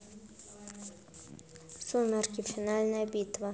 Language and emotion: Russian, neutral